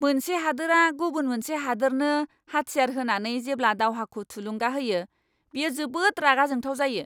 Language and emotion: Bodo, angry